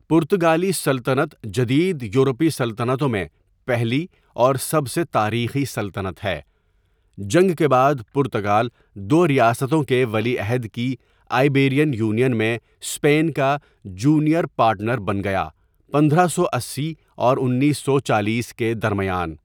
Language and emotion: Urdu, neutral